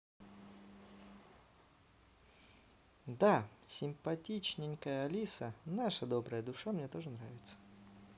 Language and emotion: Russian, positive